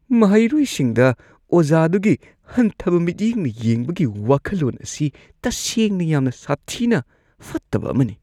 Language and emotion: Manipuri, disgusted